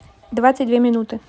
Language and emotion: Russian, neutral